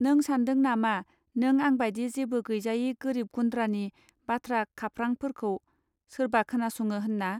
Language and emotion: Bodo, neutral